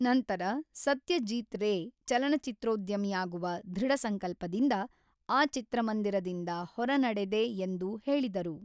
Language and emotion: Kannada, neutral